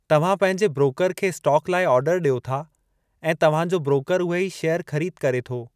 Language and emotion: Sindhi, neutral